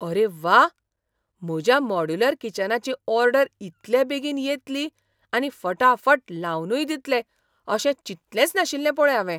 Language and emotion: Goan Konkani, surprised